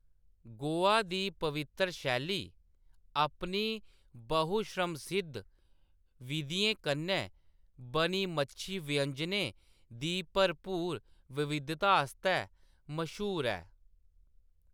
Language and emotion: Dogri, neutral